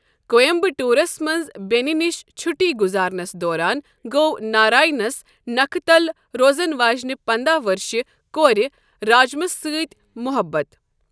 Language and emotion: Kashmiri, neutral